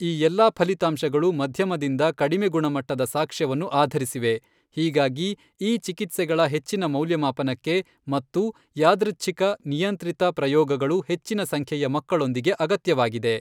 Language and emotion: Kannada, neutral